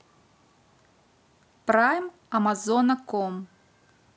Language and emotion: Russian, neutral